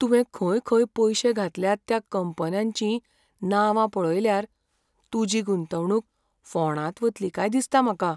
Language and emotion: Goan Konkani, fearful